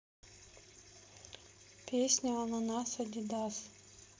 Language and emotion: Russian, neutral